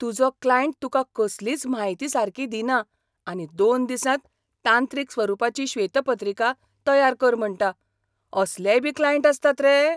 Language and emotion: Goan Konkani, surprised